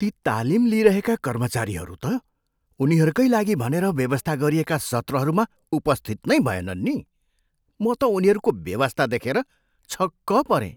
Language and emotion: Nepali, surprised